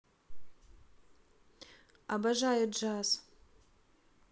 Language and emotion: Russian, neutral